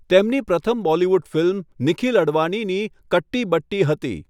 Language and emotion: Gujarati, neutral